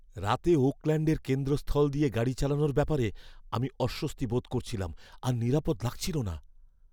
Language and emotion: Bengali, fearful